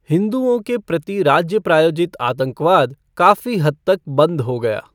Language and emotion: Hindi, neutral